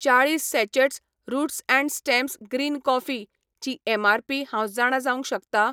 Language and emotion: Goan Konkani, neutral